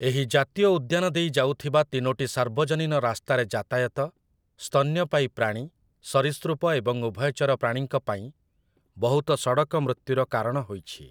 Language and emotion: Odia, neutral